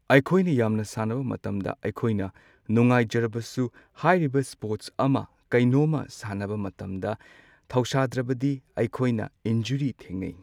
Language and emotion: Manipuri, neutral